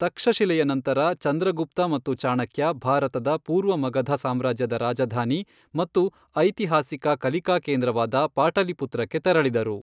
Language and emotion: Kannada, neutral